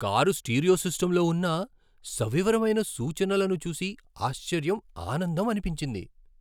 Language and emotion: Telugu, surprised